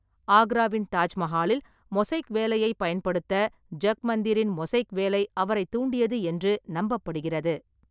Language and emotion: Tamil, neutral